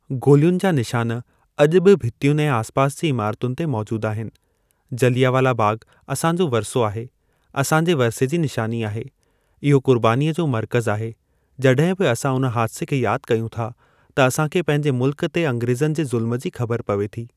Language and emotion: Sindhi, neutral